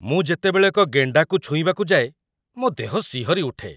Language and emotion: Odia, disgusted